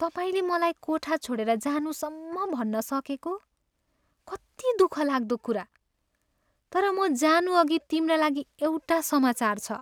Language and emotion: Nepali, sad